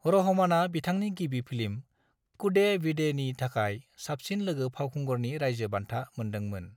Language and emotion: Bodo, neutral